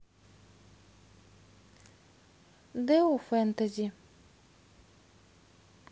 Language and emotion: Russian, neutral